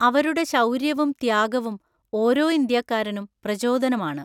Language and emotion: Malayalam, neutral